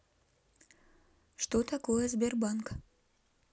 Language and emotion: Russian, neutral